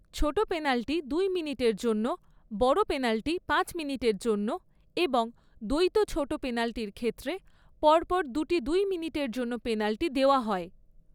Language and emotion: Bengali, neutral